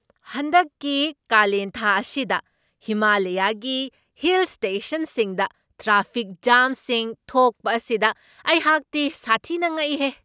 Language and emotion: Manipuri, surprised